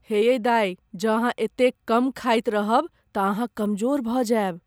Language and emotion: Maithili, fearful